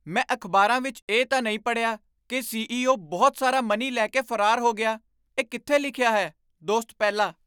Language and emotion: Punjabi, surprised